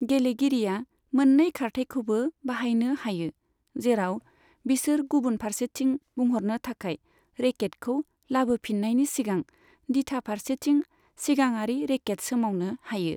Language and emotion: Bodo, neutral